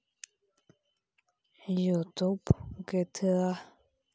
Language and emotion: Russian, neutral